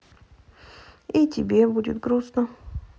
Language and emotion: Russian, sad